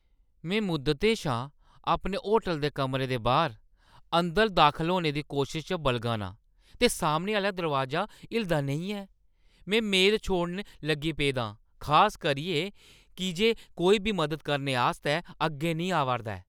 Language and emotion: Dogri, angry